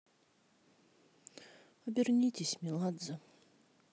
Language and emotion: Russian, sad